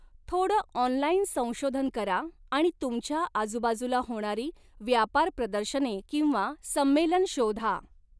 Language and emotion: Marathi, neutral